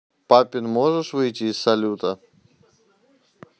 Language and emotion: Russian, neutral